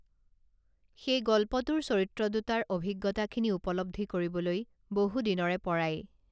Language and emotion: Assamese, neutral